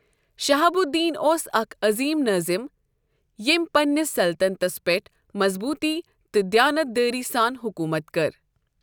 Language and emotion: Kashmiri, neutral